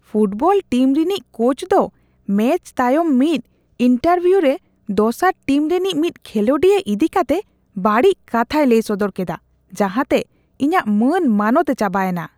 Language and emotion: Santali, disgusted